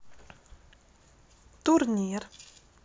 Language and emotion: Russian, neutral